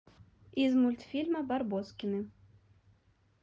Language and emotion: Russian, neutral